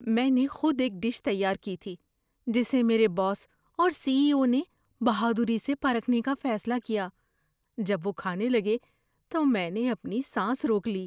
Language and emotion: Urdu, fearful